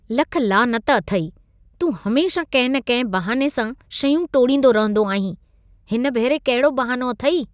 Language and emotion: Sindhi, disgusted